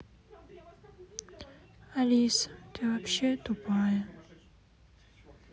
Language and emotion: Russian, sad